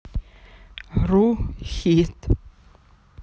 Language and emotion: Russian, neutral